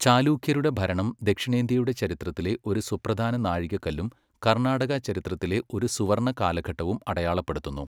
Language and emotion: Malayalam, neutral